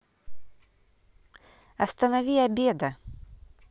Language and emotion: Russian, neutral